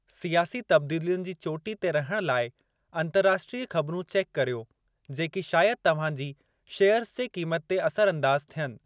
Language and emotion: Sindhi, neutral